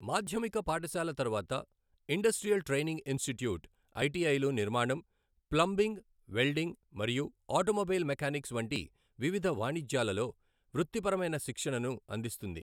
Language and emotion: Telugu, neutral